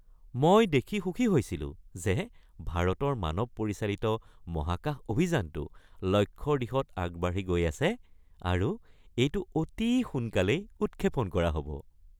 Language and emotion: Assamese, happy